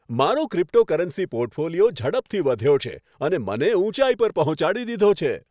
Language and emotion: Gujarati, happy